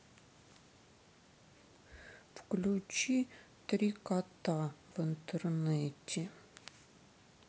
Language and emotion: Russian, sad